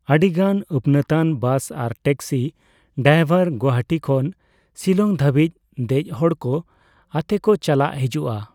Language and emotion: Santali, neutral